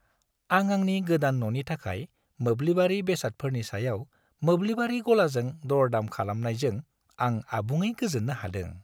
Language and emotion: Bodo, happy